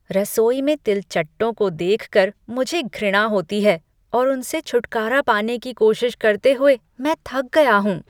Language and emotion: Hindi, disgusted